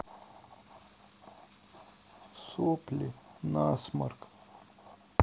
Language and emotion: Russian, sad